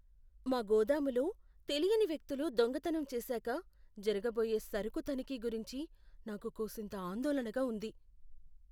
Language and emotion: Telugu, fearful